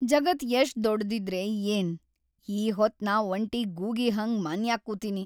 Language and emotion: Kannada, sad